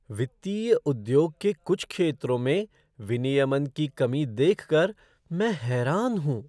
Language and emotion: Hindi, surprised